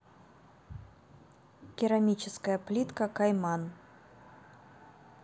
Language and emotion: Russian, neutral